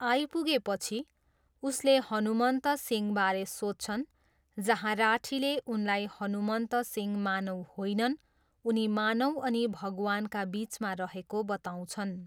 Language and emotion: Nepali, neutral